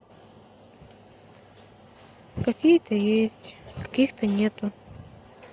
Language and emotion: Russian, sad